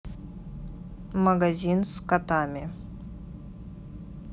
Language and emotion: Russian, neutral